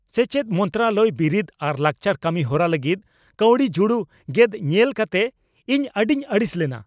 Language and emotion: Santali, angry